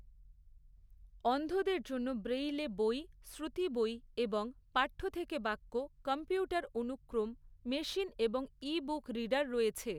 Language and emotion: Bengali, neutral